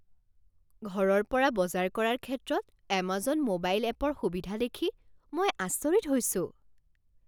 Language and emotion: Assamese, surprised